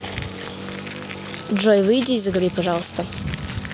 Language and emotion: Russian, neutral